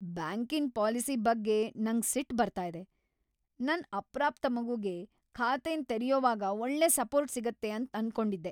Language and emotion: Kannada, angry